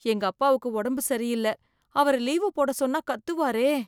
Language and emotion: Tamil, fearful